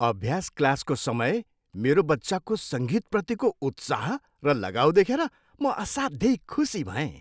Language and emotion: Nepali, happy